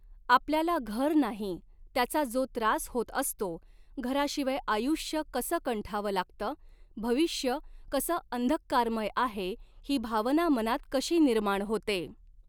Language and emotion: Marathi, neutral